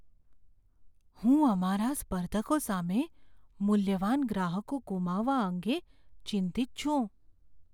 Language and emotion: Gujarati, fearful